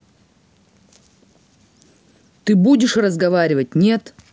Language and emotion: Russian, angry